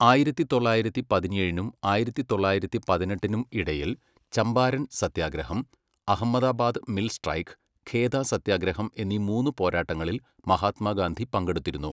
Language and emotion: Malayalam, neutral